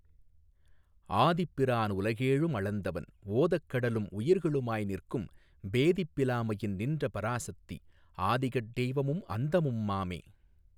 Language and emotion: Tamil, neutral